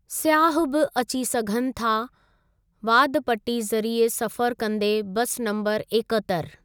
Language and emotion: Sindhi, neutral